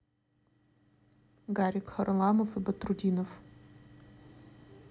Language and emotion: Russian, neutral